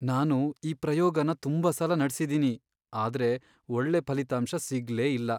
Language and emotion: Kannada, sad